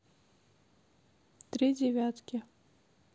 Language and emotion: Russian, neutral